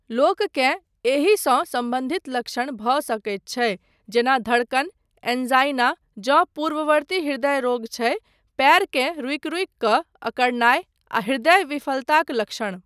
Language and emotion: Maithili, neutral